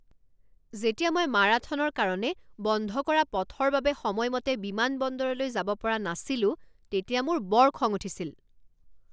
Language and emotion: Assamese, angry